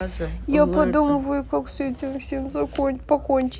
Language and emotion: Russian, sad